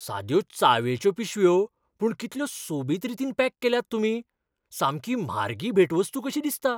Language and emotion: Goan Konkani, surprised